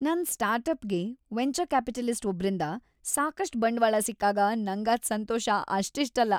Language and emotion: Kannada, happy